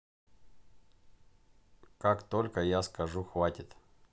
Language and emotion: Russian, neutral